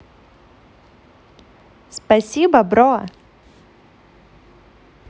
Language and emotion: Russian, positive